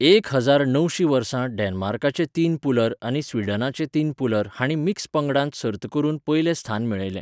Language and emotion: Goan Konkani, neutral